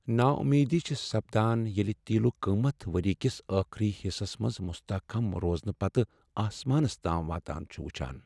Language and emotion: Kashmiri, sad